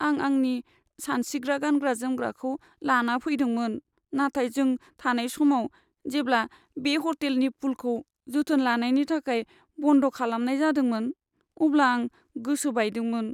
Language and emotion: Bodo, sad